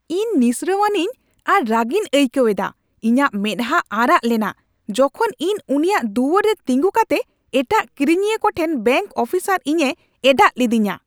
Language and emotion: Santali, angry